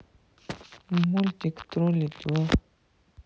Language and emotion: Russian, sad